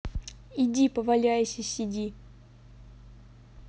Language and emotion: Russian, neutral